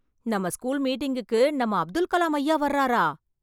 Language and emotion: Tamil, surprised